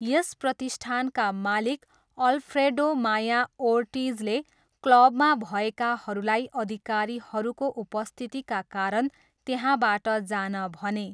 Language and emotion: Nepali, neutral